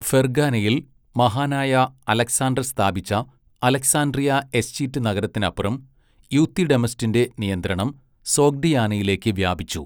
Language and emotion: Malayalam, neutral